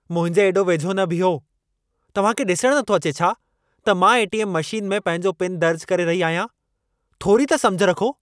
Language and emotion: Sindhi, angry